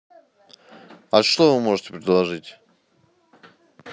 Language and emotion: Russian, neutral